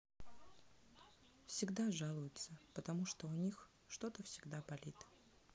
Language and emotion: Russian, sad